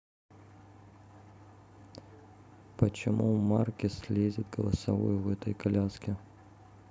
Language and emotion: Russian, neutral